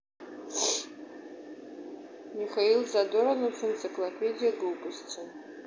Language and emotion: Russian, neutral